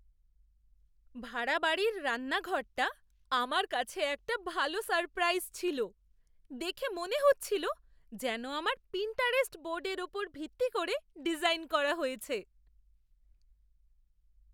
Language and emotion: Bengali, surprised